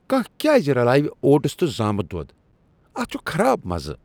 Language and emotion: Kashmiri, disgusted